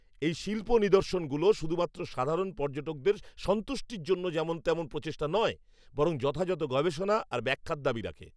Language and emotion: Bengali, angry